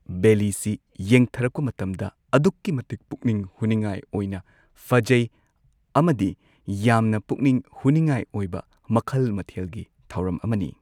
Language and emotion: Manipuri, neutral